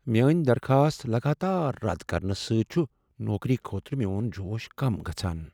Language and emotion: Kashmiri, sad